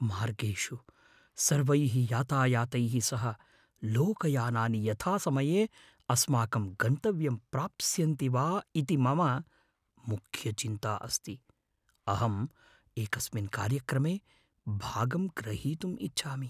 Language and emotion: Sanskrit, fearful